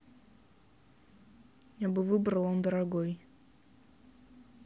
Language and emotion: Russian, neutral